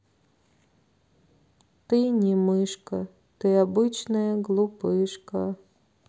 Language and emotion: Russian, sad